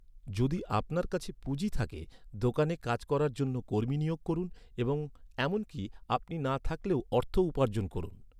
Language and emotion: Bengali, neutral